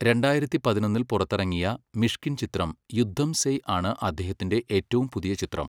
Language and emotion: Malayalam, neutral